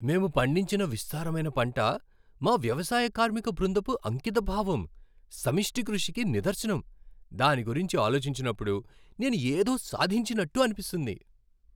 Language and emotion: Telugu, happy